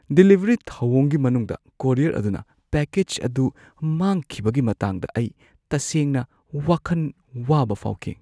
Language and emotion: Manipuri, fearful